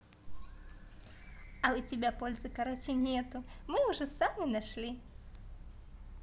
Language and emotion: Russian, positive